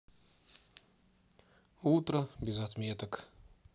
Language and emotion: Russian, sad